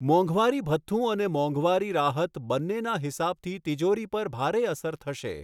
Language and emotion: Gujarati, neutral